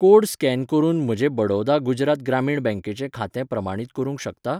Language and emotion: Goan Konkani, neutral